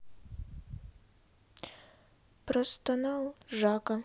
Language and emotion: Russian, sad